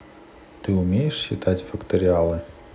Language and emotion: Russian, neutral